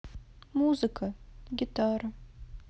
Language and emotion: Russian, sad